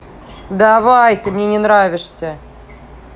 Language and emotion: Russian, angry